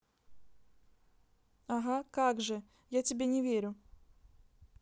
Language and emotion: Russian, neutral